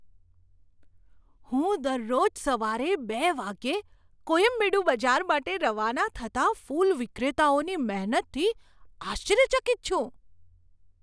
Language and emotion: Gujarati, surprised